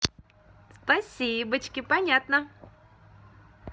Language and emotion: Russian, positive